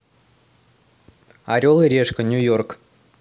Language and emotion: Russian, neutral